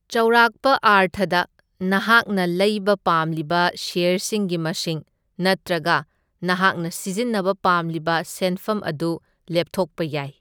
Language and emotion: Manipuri, neutral